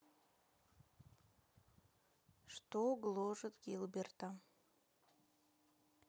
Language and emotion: Russian, neutral